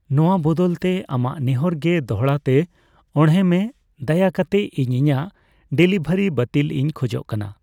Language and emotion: Santali, neutral